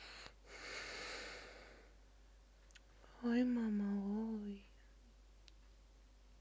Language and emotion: Russian, sad